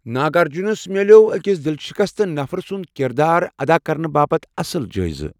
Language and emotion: Kashmiri, neutral